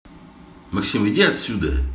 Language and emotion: Russian, angry